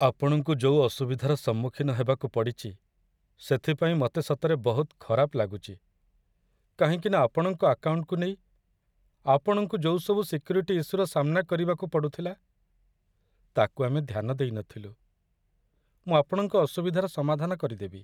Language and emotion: Odia, sad